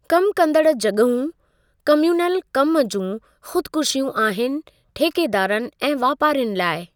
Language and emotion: Sindhi, neutral